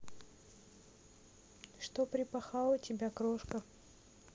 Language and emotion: Russian, neutral